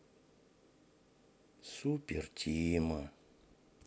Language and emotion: Russian, sad